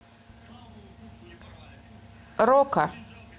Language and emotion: Russian, neutral